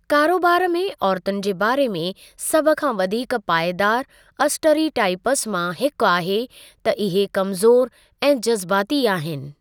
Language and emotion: Sindhi, neutral